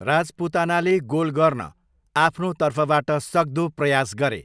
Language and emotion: Nepali, neutral